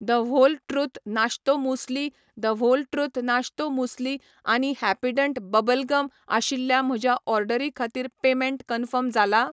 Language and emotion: Goan Konkani, neutral